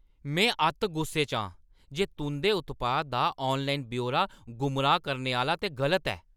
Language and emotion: Dogri, angry